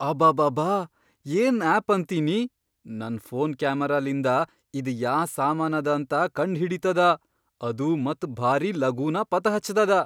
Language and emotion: Kannada, surprised